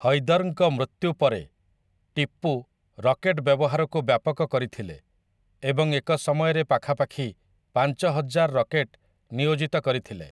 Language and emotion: Odia, neutral